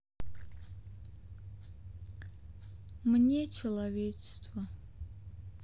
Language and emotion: Russian, sad